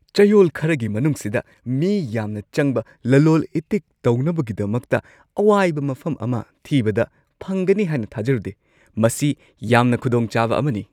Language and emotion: Manipuri, surprised